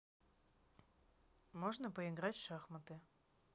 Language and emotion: Russian, neutral